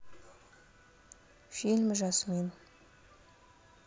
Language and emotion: Russian, neutral